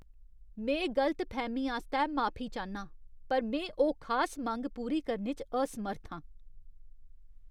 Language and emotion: Dogri, disgusted